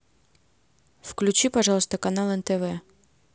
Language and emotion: Russian, neutral